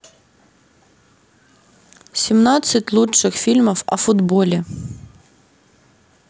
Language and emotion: Russian, neutral